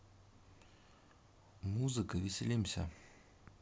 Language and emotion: Russian, neutral